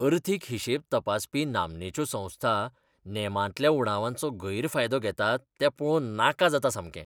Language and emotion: Goan Konkani, disgusted